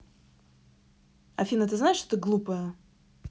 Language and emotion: Russian, angry